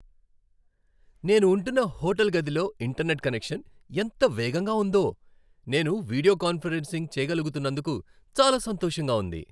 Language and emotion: Telugu, happy